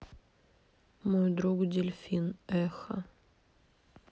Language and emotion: Russian, sad